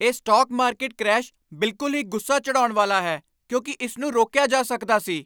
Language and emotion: Punjabi, angry